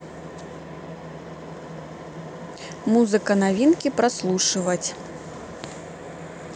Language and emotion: Russian, neutral